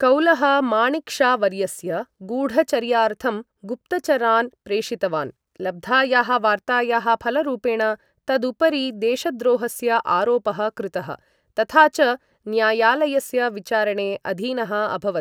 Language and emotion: Sanskrit, neutral